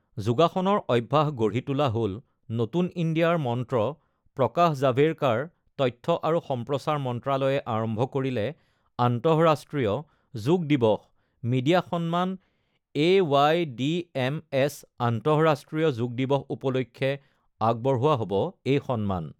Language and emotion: Assamese, neutral